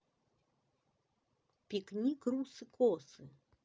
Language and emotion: Russian, neutral